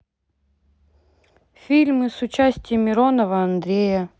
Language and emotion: Russian, neutral